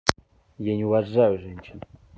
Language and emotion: Russian, angry